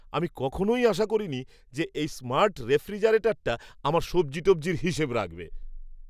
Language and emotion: Bengali, surprised